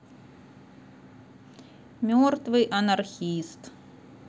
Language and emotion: Russian, neutral